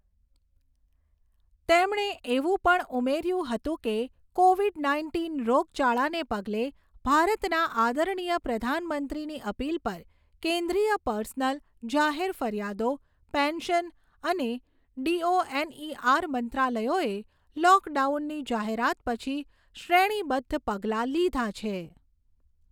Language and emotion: Gujarati, neutral